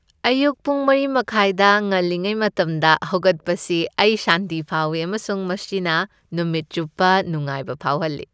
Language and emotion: Manipuri, happy